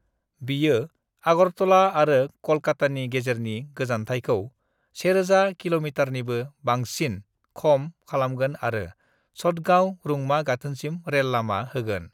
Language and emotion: Bodo, neutral